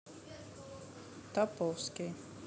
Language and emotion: Russian, neutral